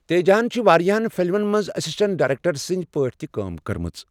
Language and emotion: Kashmiri, neutral